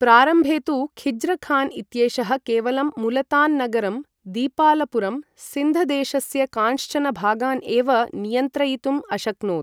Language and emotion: Sanskrit, neutral